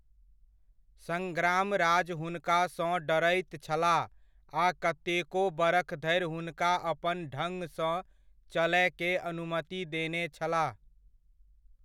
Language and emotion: Maithili, neutral